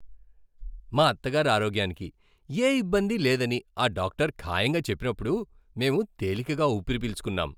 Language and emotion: Telugu, happy